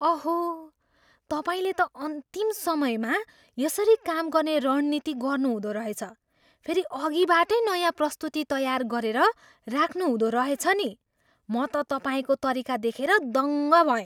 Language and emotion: Nepali, surprised